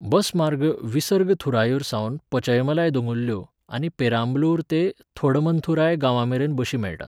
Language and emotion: Goan Konkani, neutral